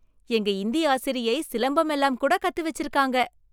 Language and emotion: Tamil, surprised